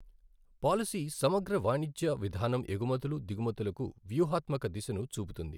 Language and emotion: Telugu, neutral